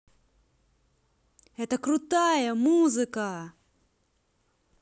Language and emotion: Russian, positive